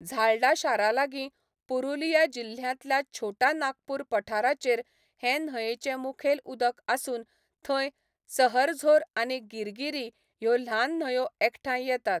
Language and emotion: Goan Konkani, neutral